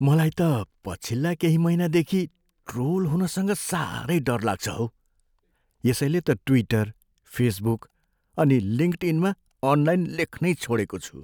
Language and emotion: Nepali, fearful